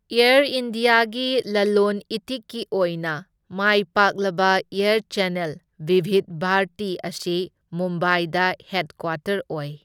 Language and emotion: Manipuri, neutral